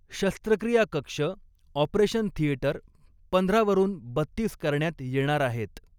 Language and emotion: Marathi, neutral